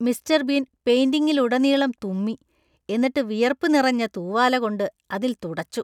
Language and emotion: Malayalam, disgusted